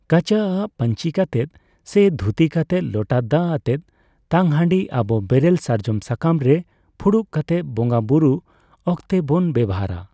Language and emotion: Santali, neutral